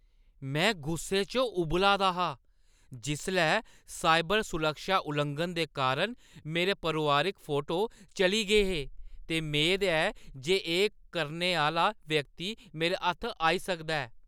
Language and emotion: Dogri, angry